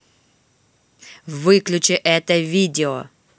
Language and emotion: Russian, angry